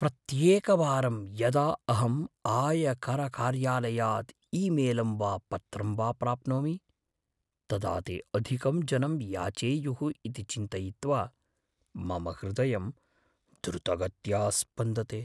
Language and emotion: Sanskrit, fearful